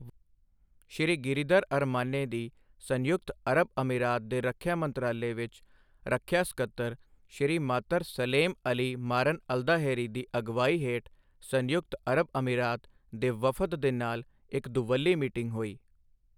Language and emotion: Punjabi, neutral